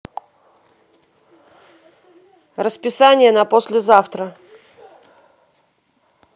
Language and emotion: Russian, neutral